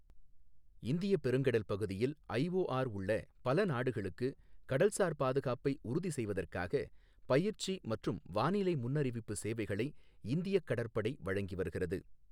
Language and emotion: Tamil, neutral